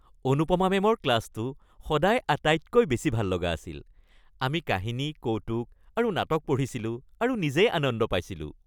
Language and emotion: Assamese, happy